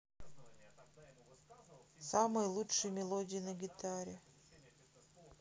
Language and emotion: Russian, sad